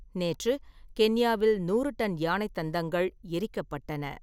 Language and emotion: Tamil, neutral